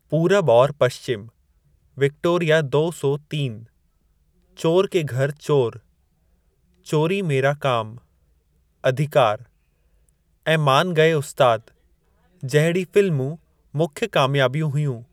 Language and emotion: Sindhi, neutral